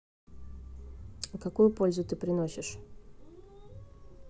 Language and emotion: Russian, neutral